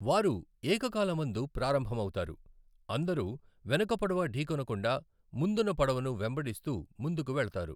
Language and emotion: Telugu, neutral